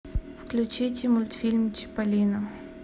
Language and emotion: Russian, neutral